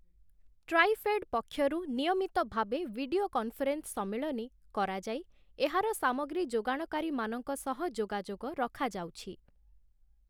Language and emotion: Odia, neutral